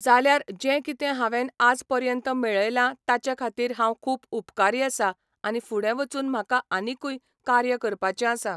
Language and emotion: Goan Konkani, neutral